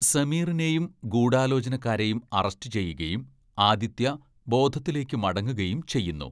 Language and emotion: Malayalam, neutral